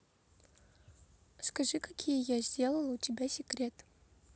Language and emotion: Russian, neutral